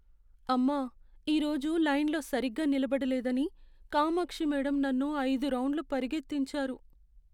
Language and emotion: Telugu, sad